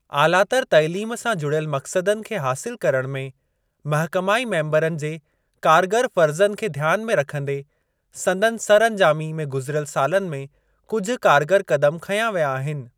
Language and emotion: Sindhi, neutral